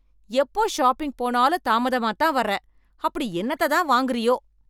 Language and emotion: Tamil, angry